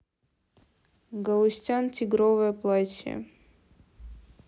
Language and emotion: Russian, neutral